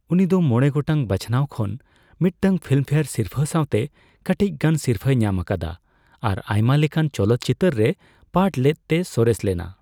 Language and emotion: Santali, neutral